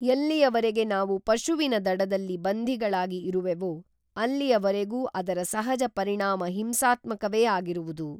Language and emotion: Kannada, neutral